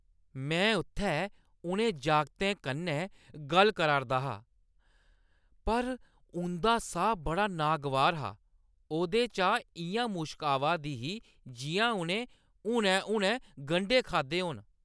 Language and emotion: Dogri, disgusted